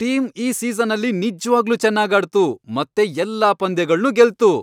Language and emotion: Kannada, happy